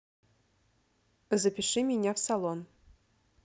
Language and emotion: Russian, neutral